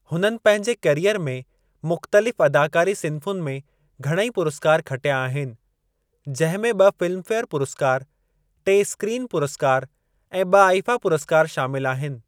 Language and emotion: Sindhi, neutral